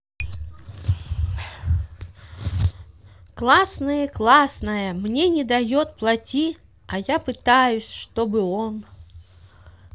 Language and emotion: Russian, positive